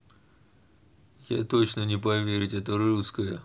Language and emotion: Russian, neutral